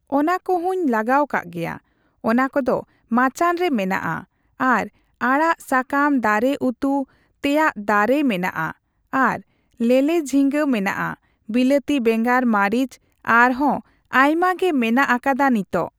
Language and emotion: Santali, neutral